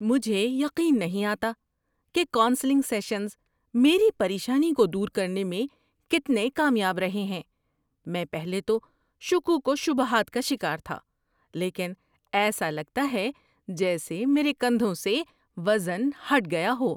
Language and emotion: Urdu, surprised